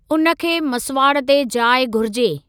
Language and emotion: Sindhi, neutral